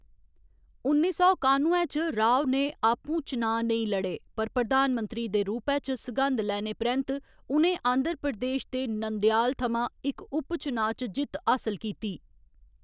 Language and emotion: Dogri, neutral